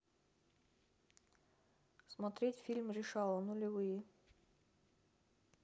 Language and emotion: Russian, neutral